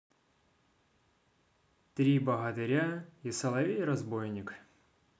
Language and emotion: Russian, neutral